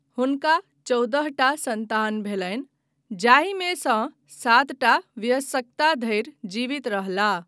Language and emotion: Maithili, neutral